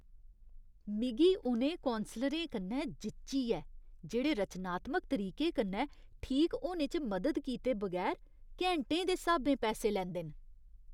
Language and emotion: Dogri, disgusted